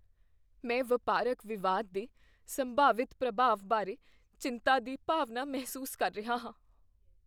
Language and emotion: Punjabi, fearful